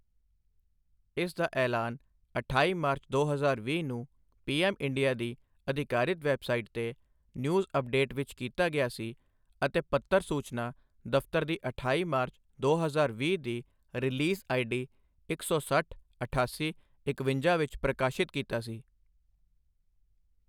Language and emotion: Punjabi, neutral